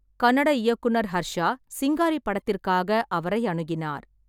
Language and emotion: Tamil, neutral